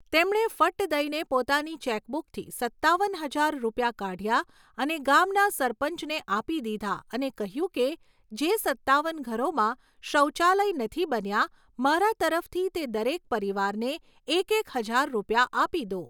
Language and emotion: Gujarati, neutral